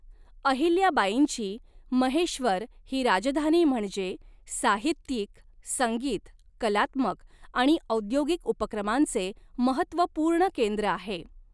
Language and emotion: Marathi, neutral